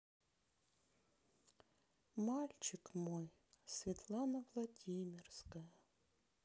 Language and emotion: Russian, sad